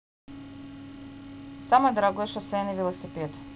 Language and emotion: Russian, neutral